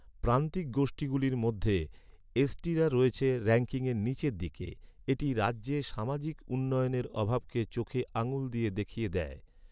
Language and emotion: Bengali, neutral